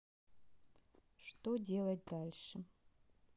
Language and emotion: Russian, sad